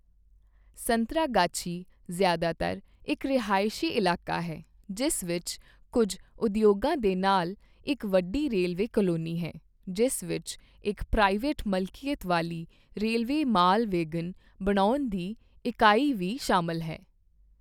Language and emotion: Punjabi, neutral